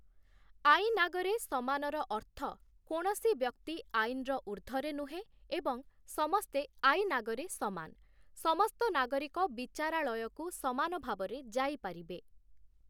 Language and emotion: Odia, neutral